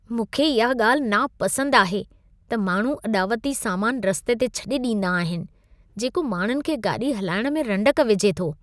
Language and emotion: Sindhi, disgusted